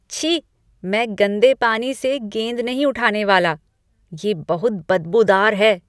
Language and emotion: Hindi, disgusted